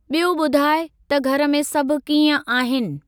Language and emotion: Sindhi, neutral